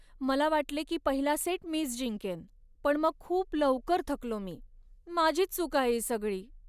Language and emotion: Marathi, sad